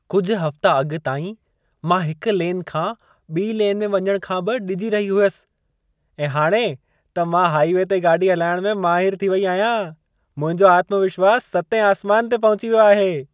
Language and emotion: Sindhi, happy